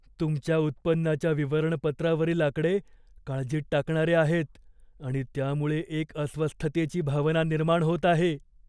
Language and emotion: Marathi, fearful